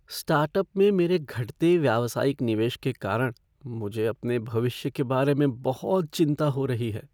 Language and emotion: Hindi, fearful